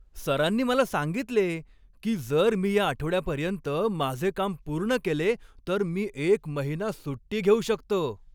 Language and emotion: Marathi, happy